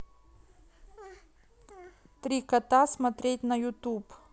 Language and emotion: Russian, neutral